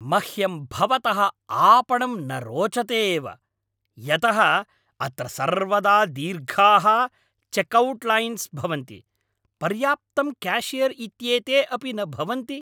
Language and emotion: Sanskrit, angry